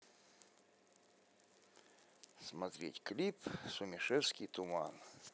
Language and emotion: Russian, neutral